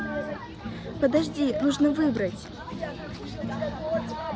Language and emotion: Russian, neutral